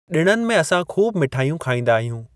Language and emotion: Sindhi, neutral